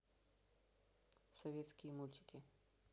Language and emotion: Russian, neutral